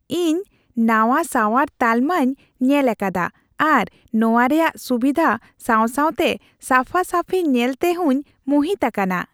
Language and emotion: Santali, happy